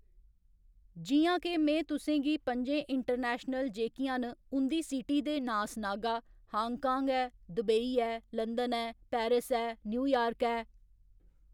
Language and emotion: Dogri, neutral